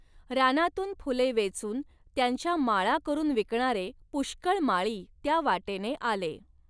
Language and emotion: Marathi, neutral